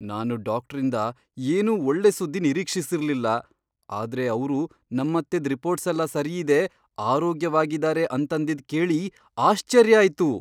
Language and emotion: Kannada, surprised